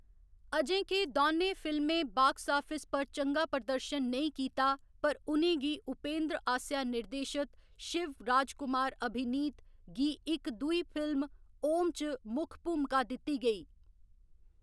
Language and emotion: Dogri, neutral